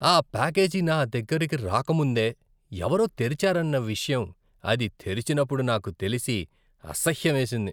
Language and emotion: Telugu, disgusted